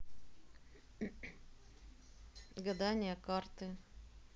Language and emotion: Russian, neutral